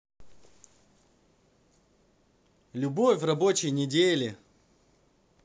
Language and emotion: Russian, positive